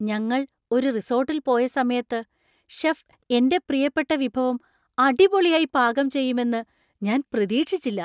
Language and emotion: Malayalam, surprised